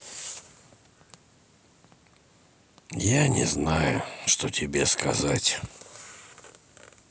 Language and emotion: Russian, sad